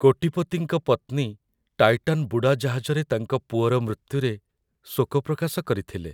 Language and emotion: Odia, sad